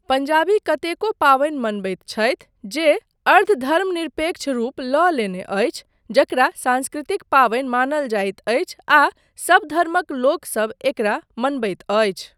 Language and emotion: Maithili, neutral